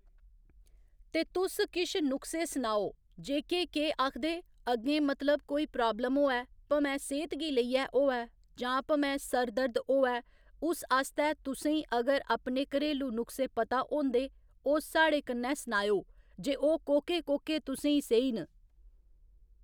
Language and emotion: Dogri, neutral